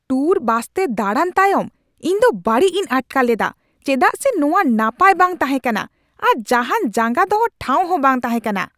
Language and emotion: Santali, angry